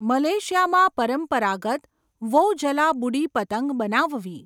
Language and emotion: Gujarati, neutral